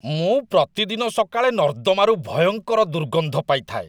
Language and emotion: Odia, disgusted